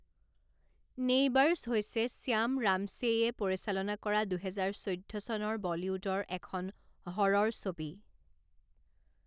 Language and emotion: Assamese, neutral